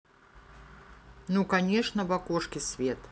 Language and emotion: Russian, neutral